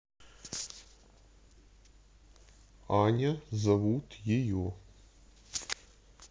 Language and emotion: Russian, neutral